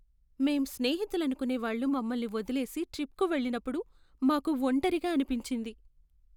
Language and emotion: Telugu, sad